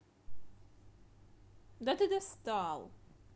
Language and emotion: Russian, angry